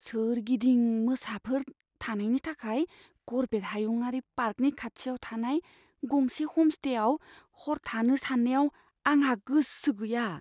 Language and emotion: Bodo, fearful